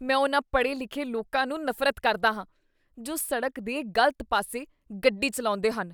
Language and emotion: Punjabi, disgusted